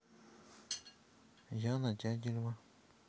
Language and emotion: Russian, neutral